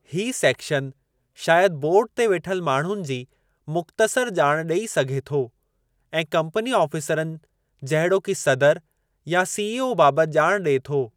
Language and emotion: Sindhi, neutral